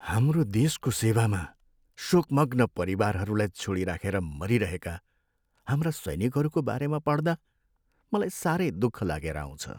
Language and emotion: Nepali, sad